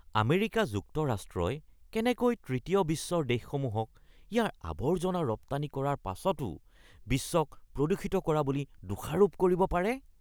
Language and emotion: Assamese, disgusted